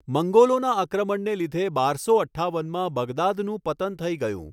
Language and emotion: Gujarati, neutral